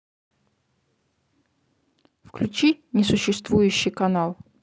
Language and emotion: Russian, neutral